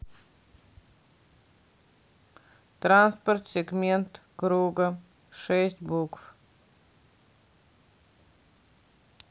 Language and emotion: Russian, neutral